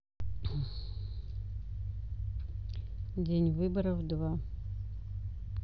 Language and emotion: Russian, neutral